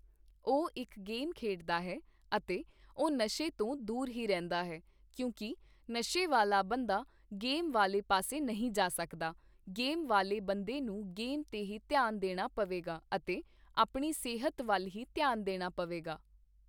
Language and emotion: Punjabi, neutral